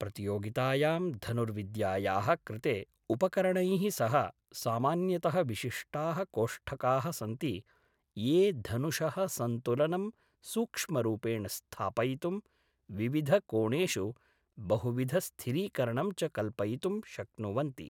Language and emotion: Sanskrit, neutral